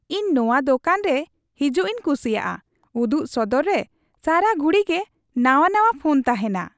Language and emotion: Santali, happy